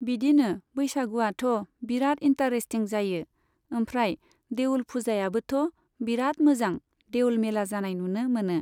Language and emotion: Bodo, neutral